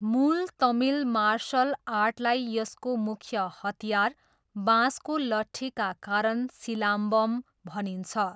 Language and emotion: Nepali, neutral